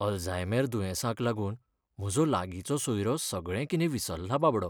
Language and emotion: Goan Konkani, sad